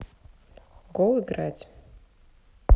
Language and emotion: Russian, neutral